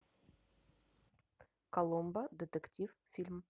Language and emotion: Russian, neutral